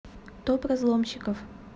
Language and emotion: Russian, neutral